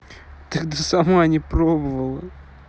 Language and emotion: Russian, neutral